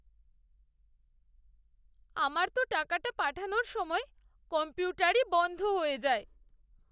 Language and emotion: Bengali, sad